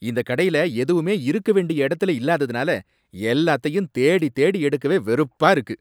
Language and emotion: Tamil, angry